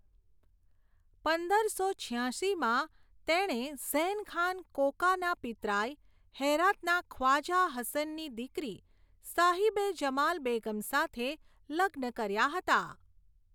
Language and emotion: Gujarati, neutral